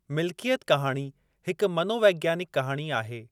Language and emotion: Sindhi, neutral